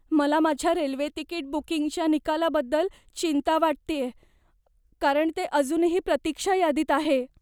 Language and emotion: Marathi, fearful